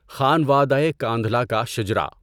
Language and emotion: Urdu, neutral